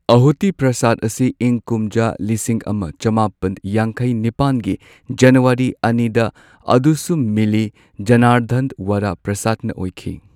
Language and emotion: Manipuri, neutral